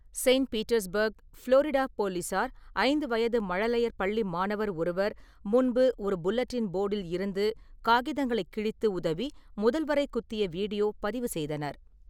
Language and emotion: Tamil, neutral